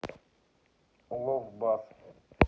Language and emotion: Russian, neutral